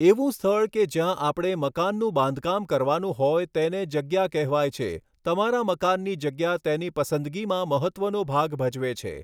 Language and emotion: Gujarati, neutral